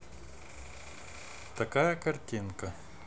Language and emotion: Russian, neutral